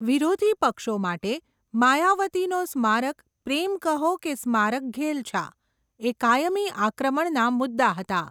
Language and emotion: Gujarati, neutral